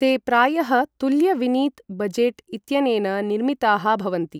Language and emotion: Sanskrit, neutral